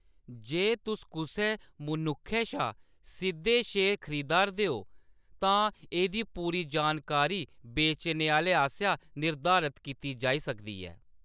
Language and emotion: Dogri, neutral